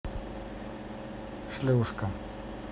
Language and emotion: Russian, neutral